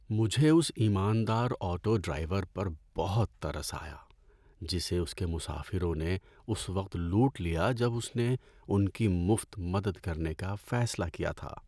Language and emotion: Urdu, sad